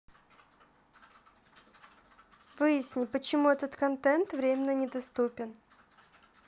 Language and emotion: Russian, neutral